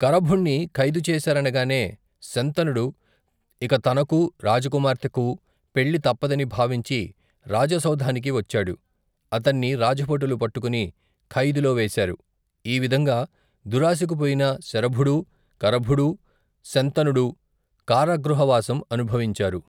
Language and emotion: Telugu, neutral